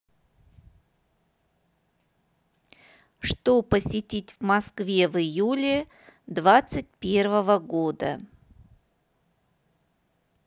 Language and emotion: Russian, neutral